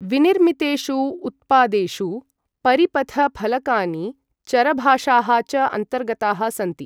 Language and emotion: Sanskrit, neutral